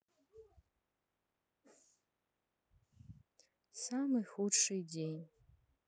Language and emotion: Russian, sad